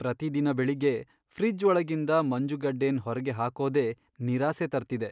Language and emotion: Kannada, sad